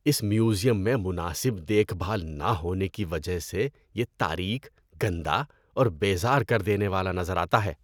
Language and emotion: Urdu, disgusted